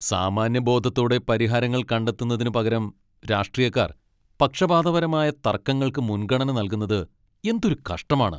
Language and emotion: Malayalam, angry